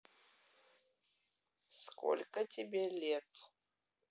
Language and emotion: Russian, neutral